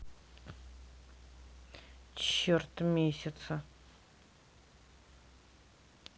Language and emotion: Russian, neutral